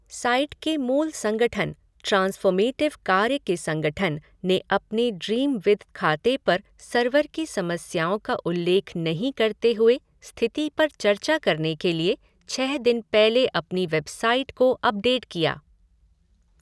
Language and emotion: Hindi, neutral